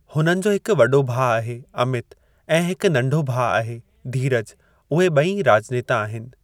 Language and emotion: Sindhi, neutral